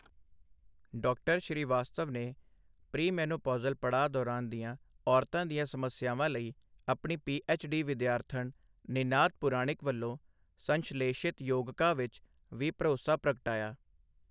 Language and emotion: Punjabi, neutral